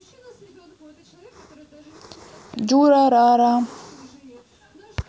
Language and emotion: Russian, neutral